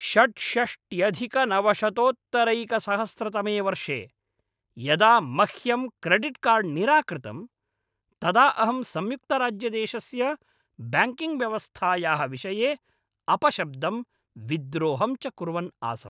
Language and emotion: Sanskrit, angry